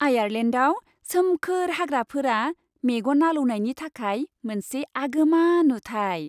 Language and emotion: Bodo, happy